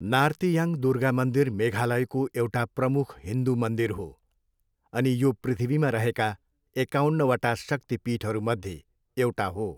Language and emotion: Nepali, neutral